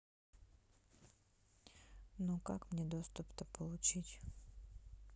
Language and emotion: Russian, sad